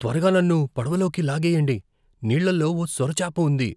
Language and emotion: Telugu, fearful